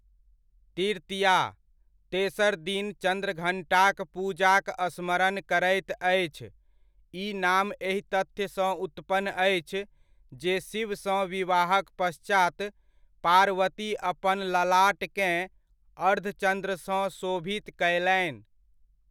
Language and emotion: Maithili, neutral